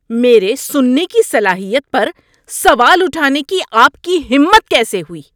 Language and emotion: Urdu, angry